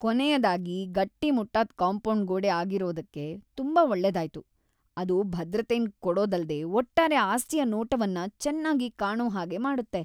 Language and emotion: Kannada, happy